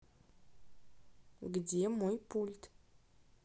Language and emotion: Russian, neutral